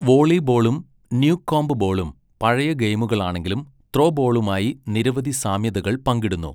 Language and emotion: Malayalam, neutral